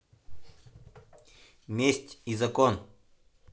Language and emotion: Russian, neutral